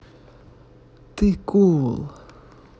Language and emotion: Russian, neutral